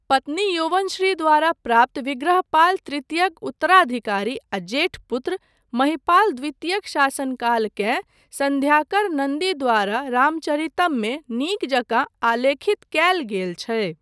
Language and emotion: Maithili, neutral